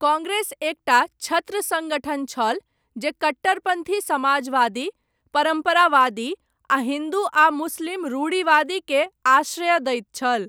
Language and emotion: Maithili, neutral